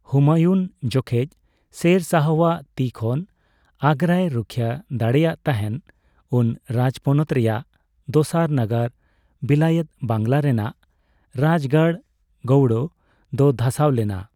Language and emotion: Santali, neutral